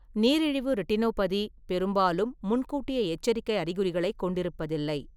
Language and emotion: Tamil, neutral